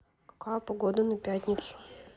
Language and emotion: Russian, neutral